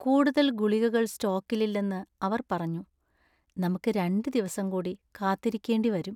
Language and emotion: Malayalam, sad